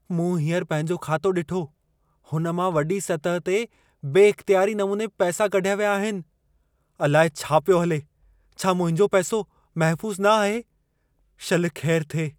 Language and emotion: Sindhi, fearful